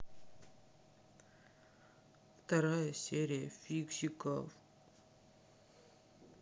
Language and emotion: Russian, sad